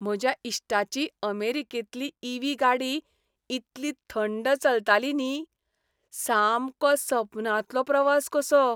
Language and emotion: Goan Konkani, happy